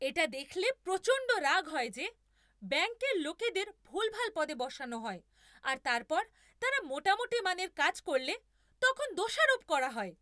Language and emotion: Bengali, angry